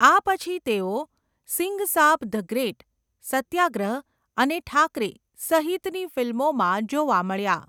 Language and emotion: Gujarati, neutral